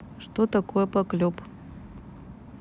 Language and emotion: Russian, neutral